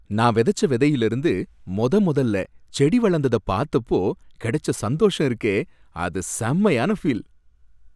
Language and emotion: Tamil, happy